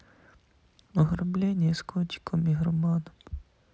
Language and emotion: Russian, sad